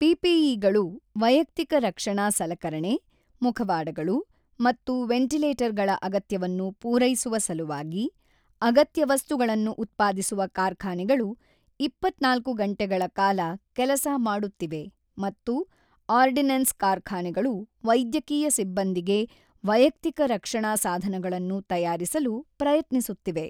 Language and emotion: Kannada, neutral